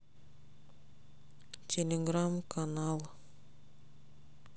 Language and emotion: Russian, sad